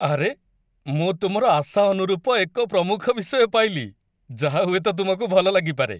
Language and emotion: Odia, happy